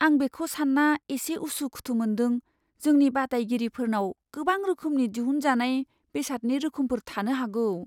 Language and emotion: Bodo, fearful